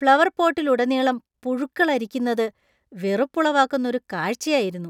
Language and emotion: Malayalam, disgusted